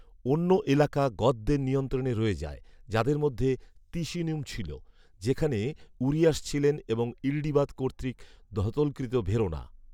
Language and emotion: Bengali, neutral